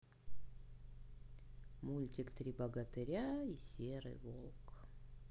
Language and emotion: Russian, sad